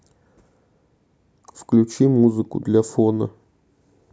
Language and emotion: Russian, sad